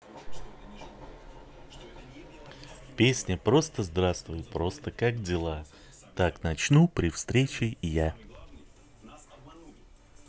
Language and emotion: Russian, positive